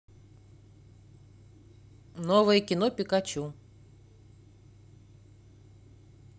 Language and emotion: Russian, neutral